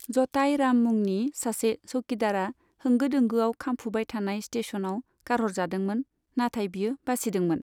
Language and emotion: Bodo, neutral